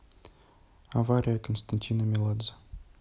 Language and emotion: Russian, neutral